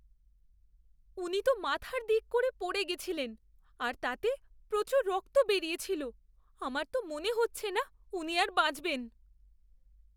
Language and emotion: Bengali, fearful